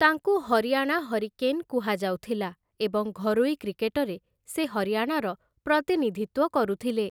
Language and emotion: Odia, neutral